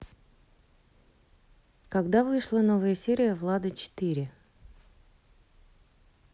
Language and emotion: Russian, neutral